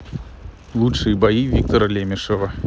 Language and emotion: Russian, neutral